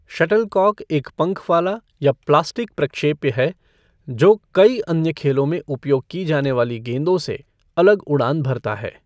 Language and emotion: Hindi, neutral